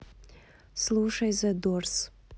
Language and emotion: Russian, neutral